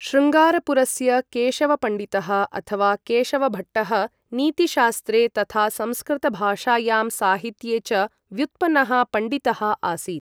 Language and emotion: Sanskrit, neutral